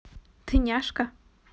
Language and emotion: Russian, positive